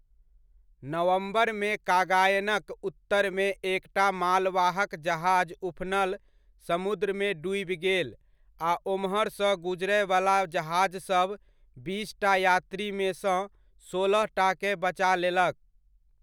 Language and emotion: Maithili, neutral